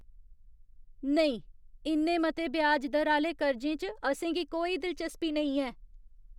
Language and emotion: Dogri, disgusted